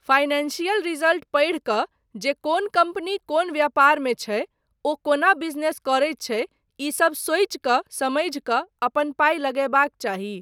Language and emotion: Maithili, neutral